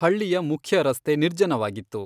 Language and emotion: Kannada, neutral